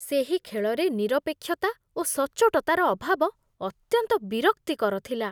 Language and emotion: Odia, disgusted